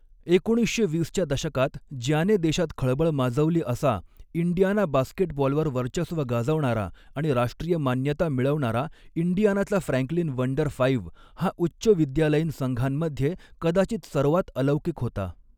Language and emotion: Marathi, neutral